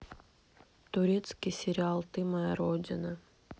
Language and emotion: Russian, neutral